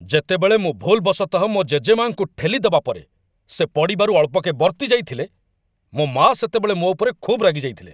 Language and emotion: Odia, angry